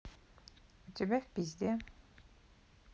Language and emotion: Russian, neutral